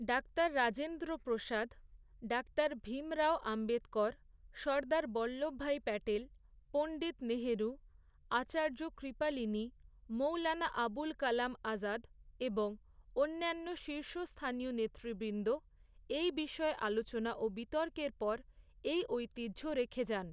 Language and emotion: Bengali, neutral